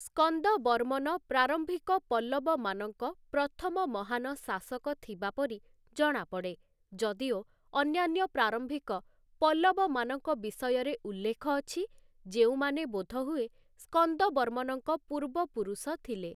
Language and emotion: Odia, neutral